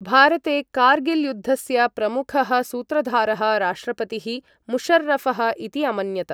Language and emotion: Sanskrit, neutral